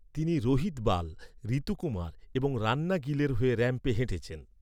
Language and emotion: Bengali, neutral